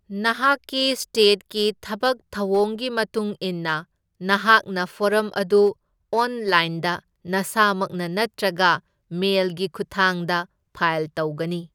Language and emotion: Manipuri, neutral